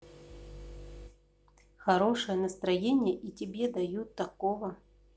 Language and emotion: Russian, neutral